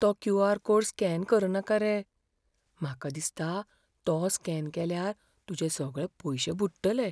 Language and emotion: Goan Konkani, fearful